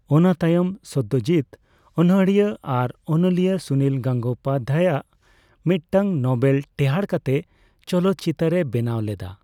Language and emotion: Santali, neutral